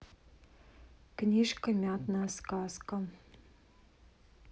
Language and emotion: Russian, neutral